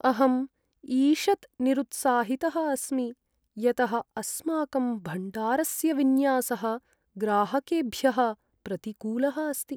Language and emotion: Sanskrit, sad